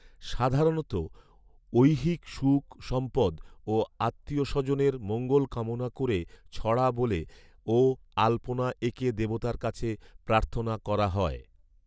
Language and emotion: Bengali, neutral